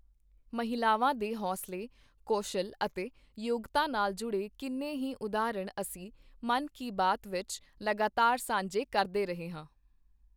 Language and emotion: Punjabi, neutral